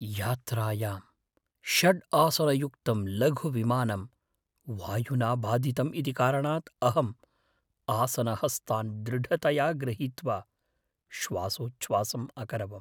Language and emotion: Sanskrit, fearful